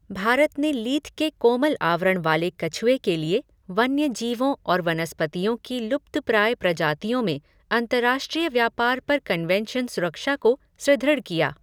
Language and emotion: Hindi, neutral